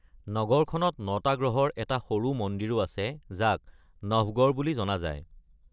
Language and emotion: Assamese, neutral